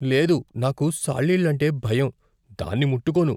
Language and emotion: Telugu, fearful